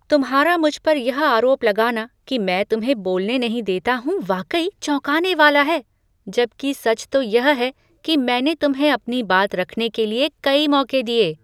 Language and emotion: Hindi, surprised